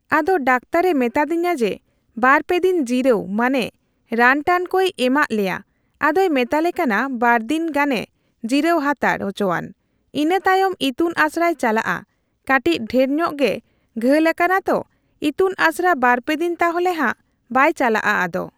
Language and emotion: Santali, neutral